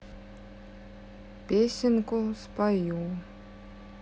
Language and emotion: Russian, sad